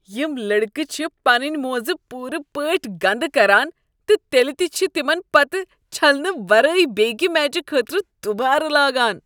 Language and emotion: Kashmiri, disgusted